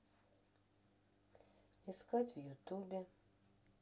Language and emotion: Russian, sad